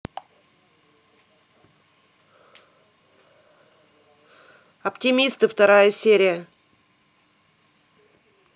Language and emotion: Russian, neutral